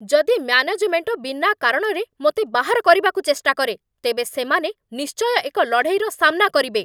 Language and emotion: Odia, angry